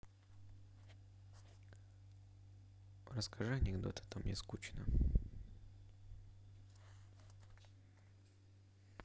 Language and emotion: Russian, neutral